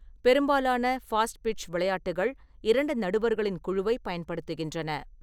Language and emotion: Tamil, neutral